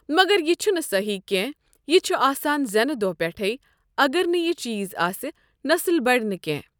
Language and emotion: Kashmiri, neutral